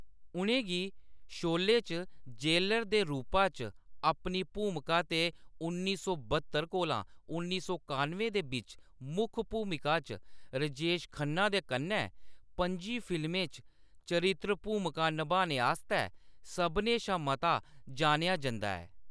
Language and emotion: Dogri, neutral